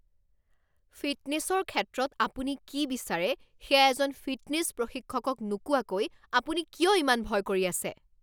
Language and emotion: Assamese, angry